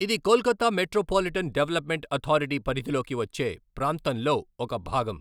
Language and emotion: Telugu, neutral